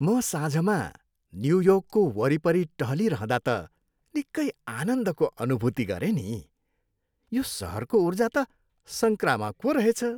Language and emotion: Nepali, happy